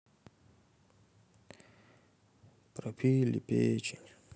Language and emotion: Russian, sad